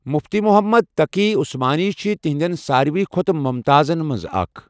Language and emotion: Kashmiri, neutral